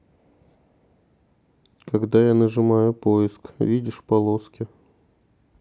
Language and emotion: Russian, sad